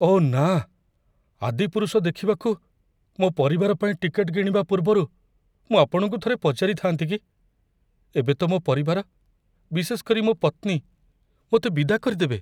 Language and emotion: Odia, fearful